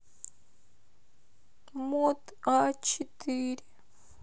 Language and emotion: Russian, sad